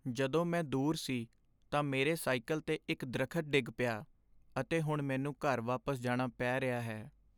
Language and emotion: Punjabi, sad